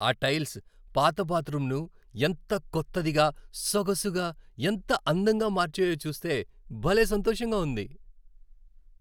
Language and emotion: Telugu, happy